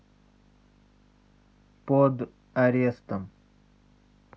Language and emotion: Russian, neutral